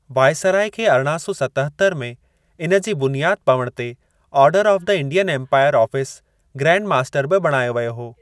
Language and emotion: Sindhi, neutral